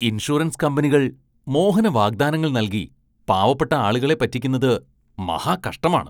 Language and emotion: Malayalam, disgusted